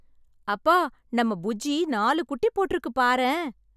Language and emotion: Tamil, happy